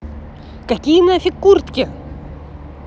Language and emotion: Russian, angry